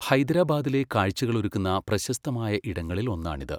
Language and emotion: Malayalam, neutral